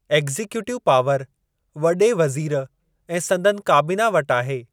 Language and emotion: Sindhi, neutral